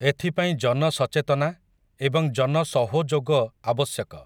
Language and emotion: Odia, neutral